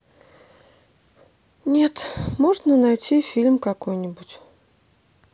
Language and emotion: Russian, sad